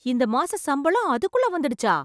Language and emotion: Tamil, surprised